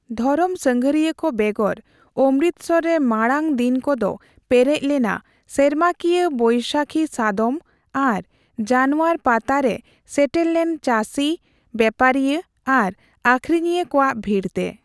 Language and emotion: Santali, neutral